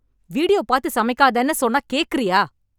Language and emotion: Tamil, angry